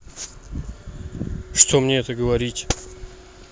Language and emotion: Russian, neutral